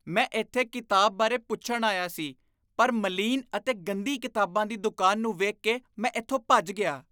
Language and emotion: Punjabi, disgusted